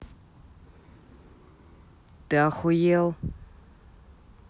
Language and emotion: Russian, angry